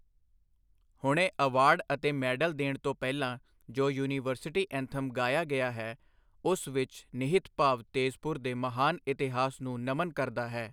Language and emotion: Punjabi, neutral